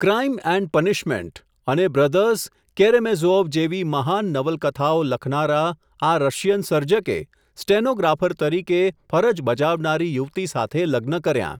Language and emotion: Gujarati, neutral